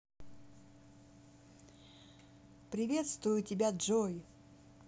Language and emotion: Russian, positive